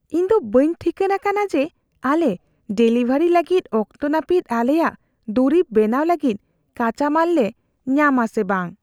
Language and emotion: Santali, fearful